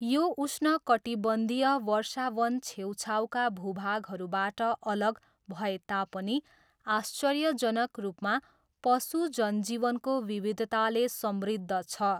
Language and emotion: Nepali, neutral